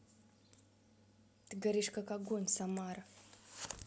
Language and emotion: Russian, neutral